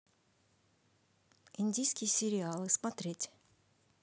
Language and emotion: Russian, neutral